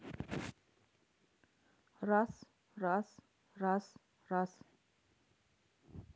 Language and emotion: Russian, neutral